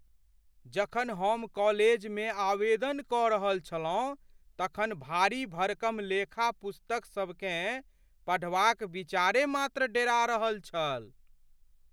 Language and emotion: Maithili, fearful